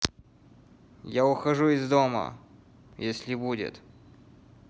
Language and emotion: Russian, angry